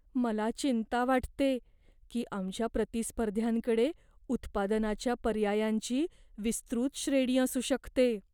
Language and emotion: Marathi, fearful